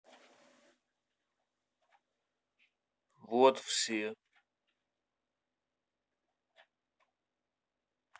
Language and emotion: Russian, neutral